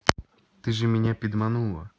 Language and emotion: Russian, neutral